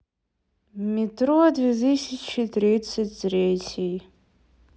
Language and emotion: Russian, sad